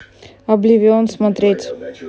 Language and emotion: Russian, neutral